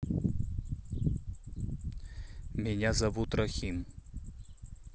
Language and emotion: Russian, neutral